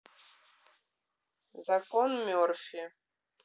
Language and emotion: Russian, neutral